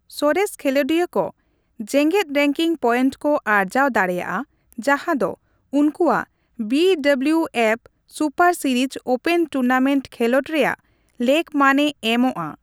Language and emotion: Santali, neutral